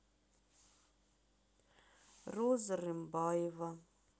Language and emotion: Russian, sad